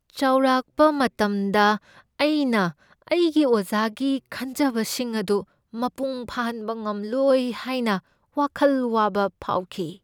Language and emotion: Manipuri, fearful